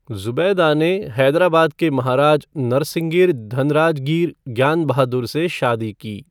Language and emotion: Hindi, neutral